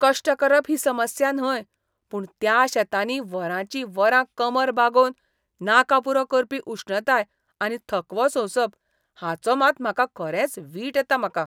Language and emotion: Goan Konkani, disgusted